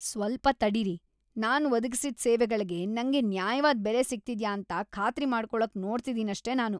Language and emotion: Kannada, disgusted